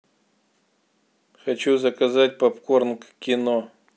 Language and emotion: Russian, neutral